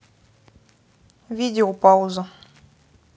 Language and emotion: Russian, neutral